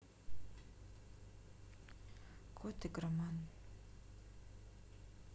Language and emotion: Russian, sad